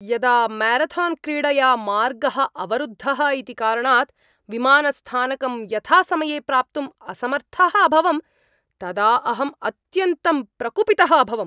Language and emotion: Sanskrit, angry